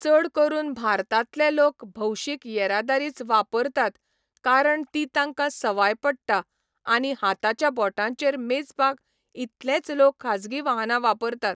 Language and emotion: Goan Konkani, neutral